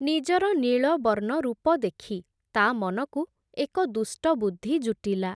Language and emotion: Odia, neutral